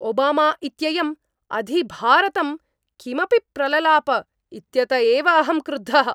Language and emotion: Sanskrit, angry